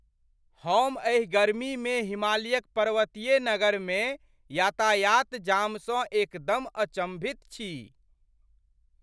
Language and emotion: Maithili, surprised